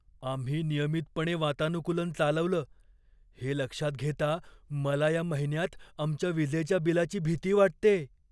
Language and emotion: Marathi, fearful